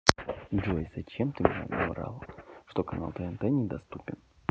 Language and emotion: Russian, sad